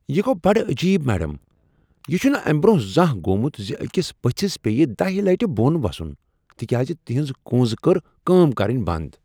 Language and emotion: Kashmiri, surprised